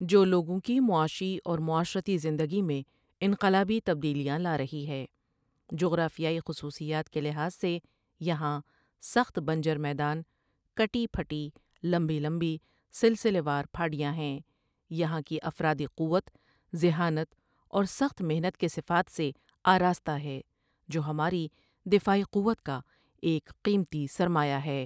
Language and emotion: Urdu, neutral